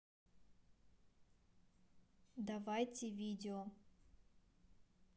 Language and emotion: Russian, neutral